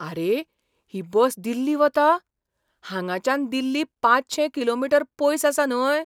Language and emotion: Goan Konkani, surprised